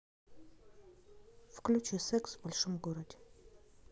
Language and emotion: Russian, neutral